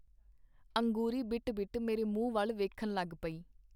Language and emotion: Punjabi, neutral